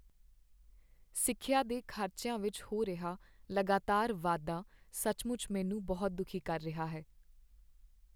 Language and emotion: Punjabi, sad